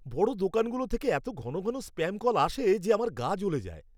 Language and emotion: Bengali, angry